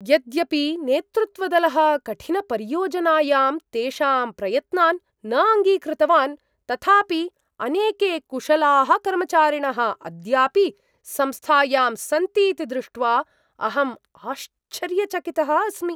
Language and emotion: Sanskrit, surprised